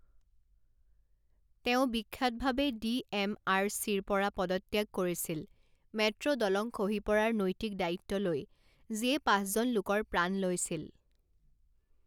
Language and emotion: Assamese, neutral